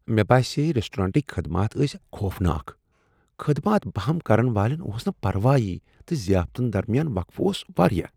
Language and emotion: Kashmiri, disgusted